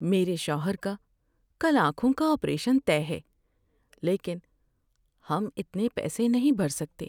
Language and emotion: Urdu, sad